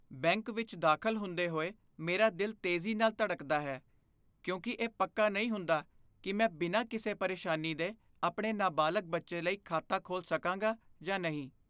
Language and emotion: Punjabi, fearful